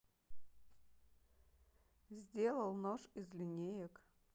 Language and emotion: Russian, neutral